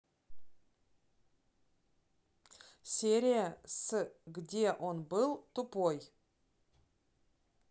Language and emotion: Russian, neutral